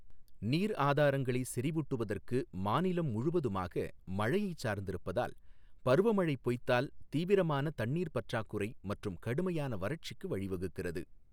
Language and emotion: Tamil, neutral